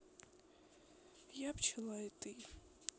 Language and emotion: Russian, sad